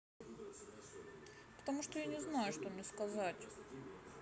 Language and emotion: Russian, sad